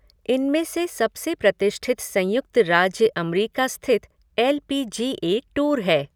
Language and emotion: Hindi, neutral